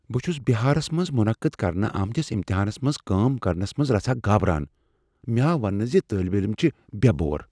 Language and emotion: Kashmiri, fearful